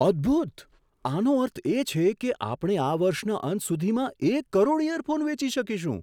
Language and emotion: Gujarati, surprised